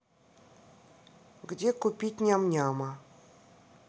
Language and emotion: Russian, neutral